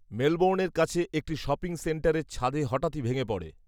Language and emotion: Bengali, neutral